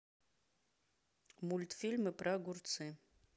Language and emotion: Russian, neutral